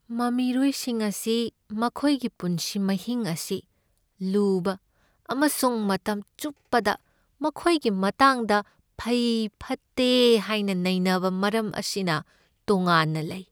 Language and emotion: Manipuri, sad